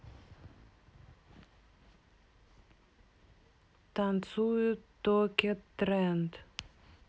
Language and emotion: Russian, neutral